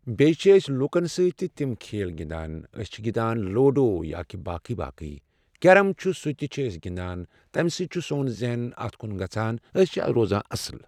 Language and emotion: Kashmiri, neutral